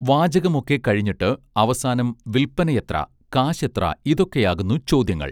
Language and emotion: Malayalam, neutral